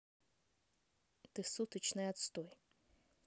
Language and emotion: Russian, angry